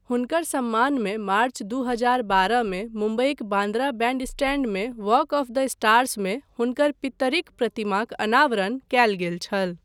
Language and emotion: Maithili, neutral